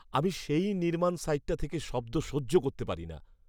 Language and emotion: Bengali, disgusted